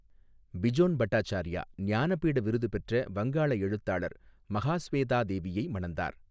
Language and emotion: Tamil, neutral